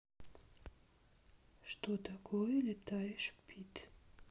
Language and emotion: Russian, neutral